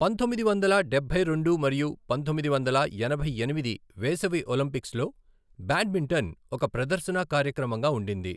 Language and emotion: Telugu, neutral